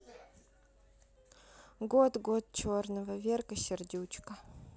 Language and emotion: Russian, sad